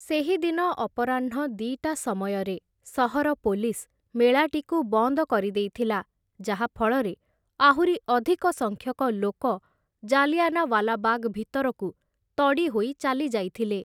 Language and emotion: Odia, neutral